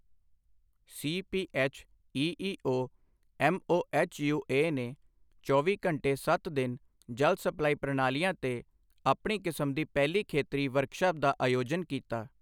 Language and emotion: Punjabi, neutral